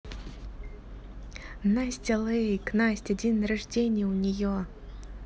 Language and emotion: Russian, positive